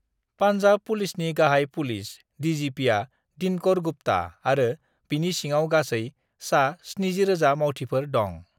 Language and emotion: Bodo, neutral